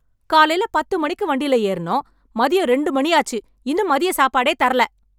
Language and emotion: Tamil, angry